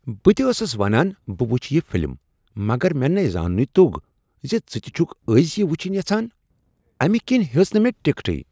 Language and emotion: Kashmiri, surprised